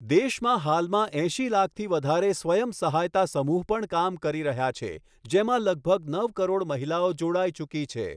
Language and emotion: Gujarati, neutral